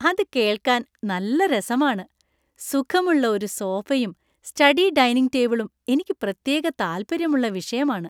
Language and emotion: Malayalam, happy